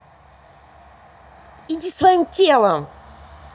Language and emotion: Russian, angry